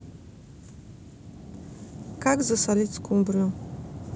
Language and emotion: Russian, neutral